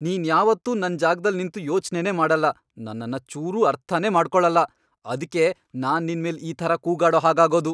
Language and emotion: Kannada, angry